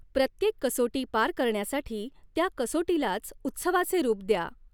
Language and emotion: Marathi, neutral